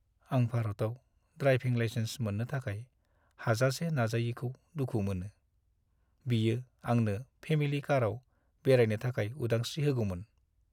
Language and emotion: Bodo, sad